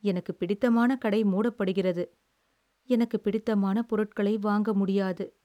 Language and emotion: Tamil, sad